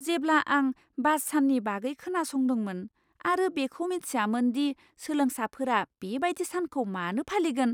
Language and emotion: Bodo, surprised